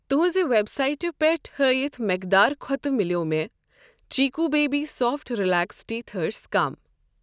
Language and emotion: Kashmiri, neutral